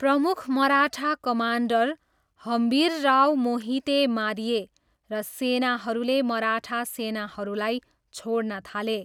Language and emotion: Nepali, neutral